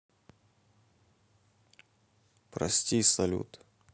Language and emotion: Russian, sad